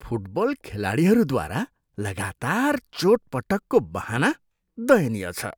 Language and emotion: Nepali, disgusted